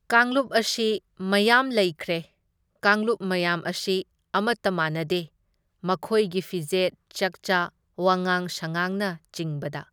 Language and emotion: Manipuri, neutral